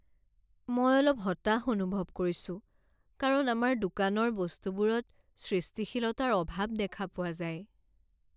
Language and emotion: Assamese, sad